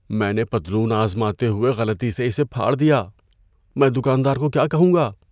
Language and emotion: Urdu, fearful